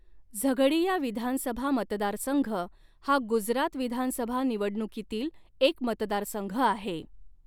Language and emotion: Marathi, neutral